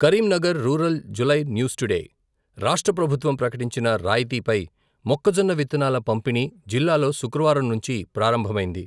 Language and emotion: Telugu, neutral